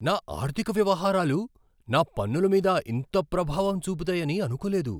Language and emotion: Telugu, surprised